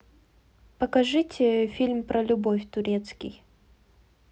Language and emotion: Russian, neutral